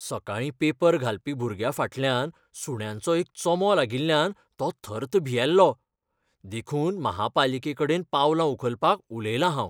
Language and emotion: Goan Konkani, fearful